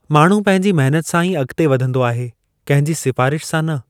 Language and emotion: Sindhi, neutral